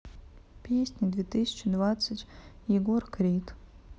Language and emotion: Russian, neutral